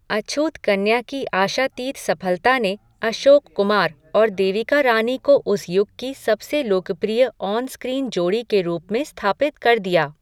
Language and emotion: Hindi, neutral